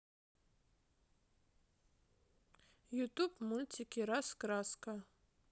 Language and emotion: Russian, neutral